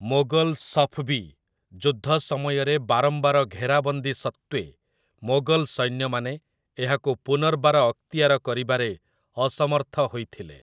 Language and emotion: Odia, neutral